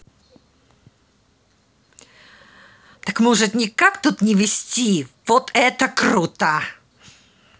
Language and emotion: Russian, angry